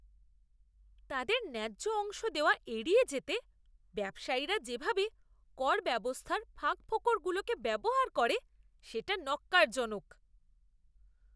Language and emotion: Bengali, disgusted